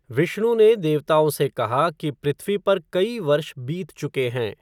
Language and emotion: Hindi, neutral